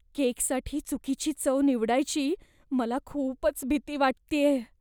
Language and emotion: Marathi, fearful